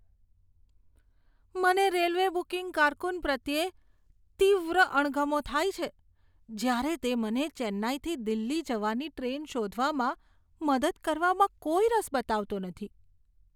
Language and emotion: Gujarati, disgusted